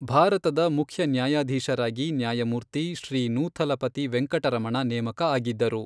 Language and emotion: Kannada, neutral